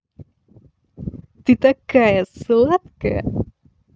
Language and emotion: Russian, positive